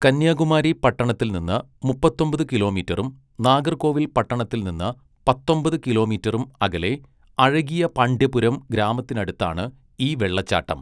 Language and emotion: Malayalam, neutral